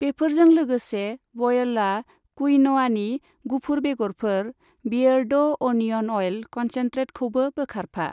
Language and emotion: Bodo, neutral